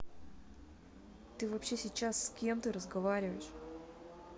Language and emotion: Russian, angry